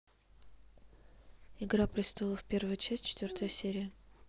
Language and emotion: Russian, neutral